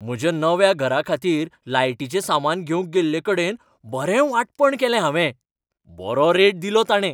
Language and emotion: Goan Konkani, happy